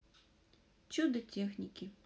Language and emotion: Russian, neutral